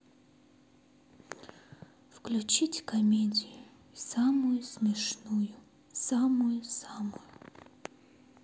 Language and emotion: Russian, sad